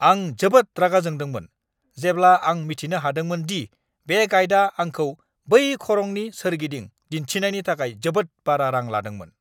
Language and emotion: Bodo, angry